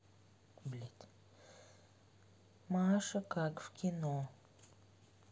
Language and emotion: Russian, neutral